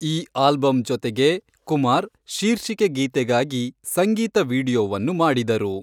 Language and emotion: Kannada, neutral